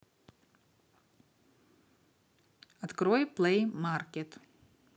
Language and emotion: Russian, neutral